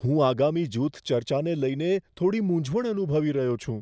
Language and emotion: Gujarati, fearful